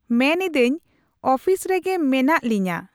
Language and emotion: Santali, neutral